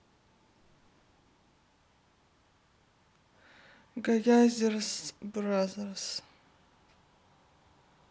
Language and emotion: Russian, sad